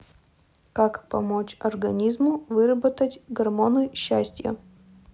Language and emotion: Russian, neutral